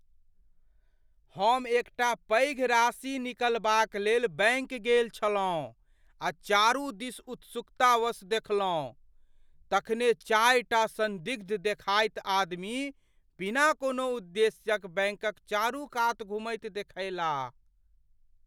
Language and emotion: Maithili, fearful